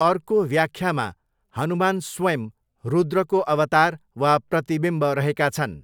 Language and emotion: Nepali, neutral